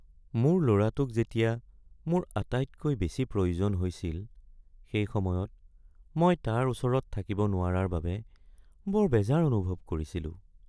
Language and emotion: Assamese, sad